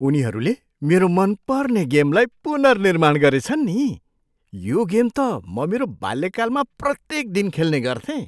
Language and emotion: Nepali, surprised